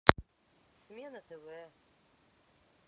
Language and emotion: Russian, neutral